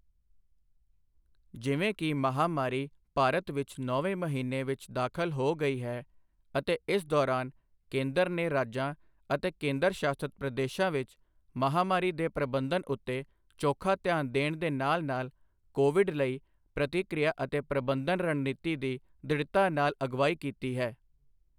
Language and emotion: Punjabi, neutral